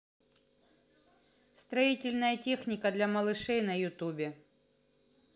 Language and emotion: Russian, neutral